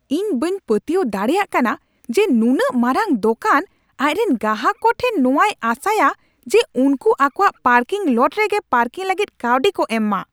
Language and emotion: Santali, angry